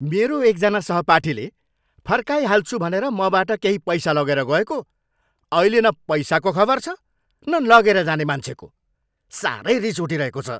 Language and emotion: Nepali, angry